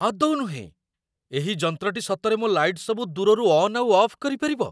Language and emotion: Odia, surprised